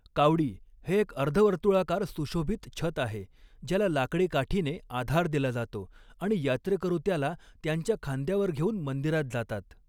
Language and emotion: Marathi, neutral